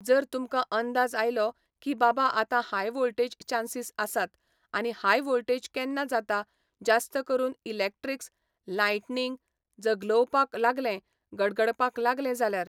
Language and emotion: Goan Konkani, neutral